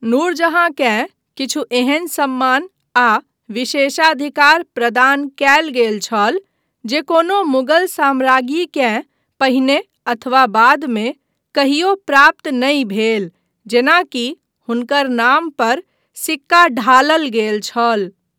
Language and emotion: Maithili, neutral